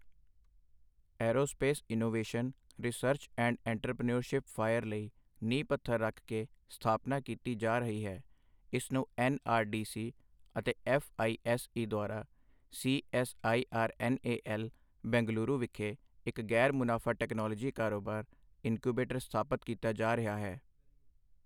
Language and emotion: Punjabi, neutral